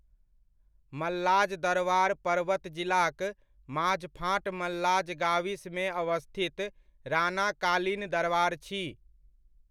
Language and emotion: Maithili, neutral